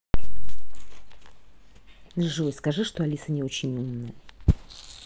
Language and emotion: Russian, neutral